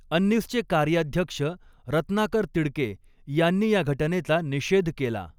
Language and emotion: Marathi, neutral